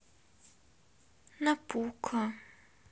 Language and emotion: Russian, sad